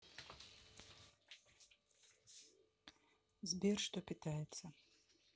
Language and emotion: Russian, neutral